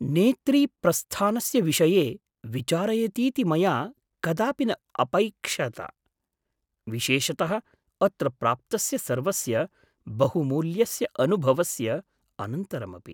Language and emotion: Sanskrit, surprised